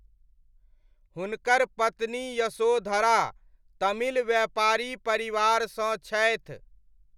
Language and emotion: Maithili, neutral